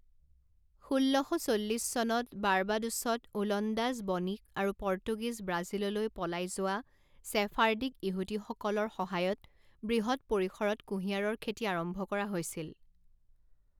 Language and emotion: Assamese, neutral